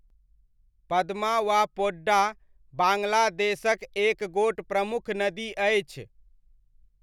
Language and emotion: Maithili, neutral